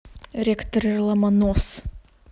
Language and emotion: Russian, angry